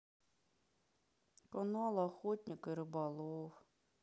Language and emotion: Russian, sad